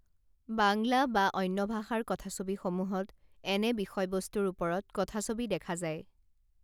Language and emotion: Assamese, neutral